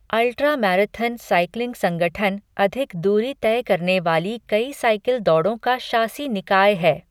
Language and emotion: Hindi, neutral